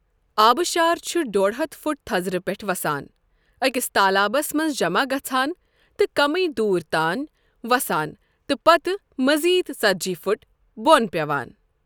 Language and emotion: Kashmiri, neutral